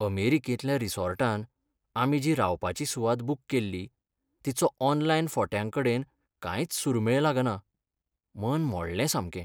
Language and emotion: Goan Konkani, sad